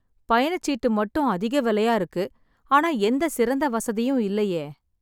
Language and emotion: Tamil, sad